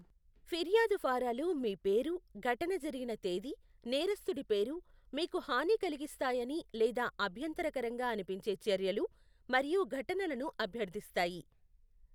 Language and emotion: Telugu, neutral